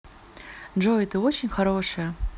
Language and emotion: Russian, positive